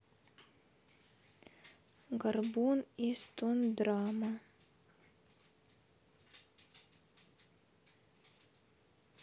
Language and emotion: Russian, neutral